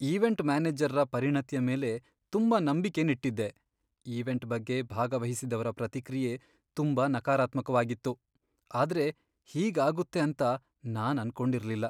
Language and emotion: Kannada, sad